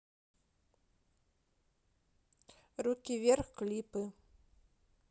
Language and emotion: Russian, neutral